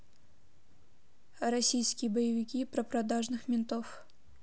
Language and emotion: Russian, neutral